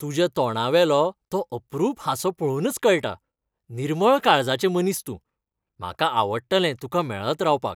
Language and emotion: Goan Konkani, happy